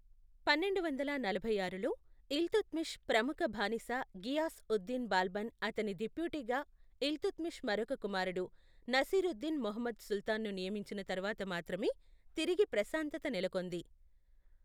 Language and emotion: Telugu, neutral